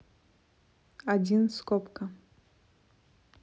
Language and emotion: Russian, neutral